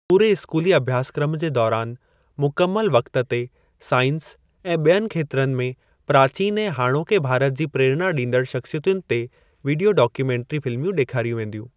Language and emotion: Sindhi, neutral